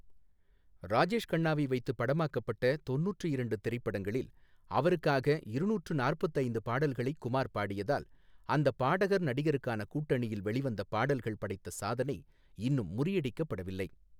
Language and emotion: Tamil, neutral